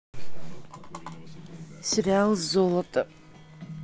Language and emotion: Russian, neutral